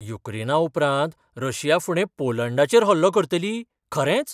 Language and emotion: Goan Konkani, surprised